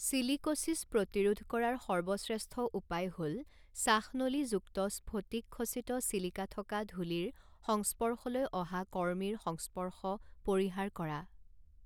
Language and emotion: Assamese, neutral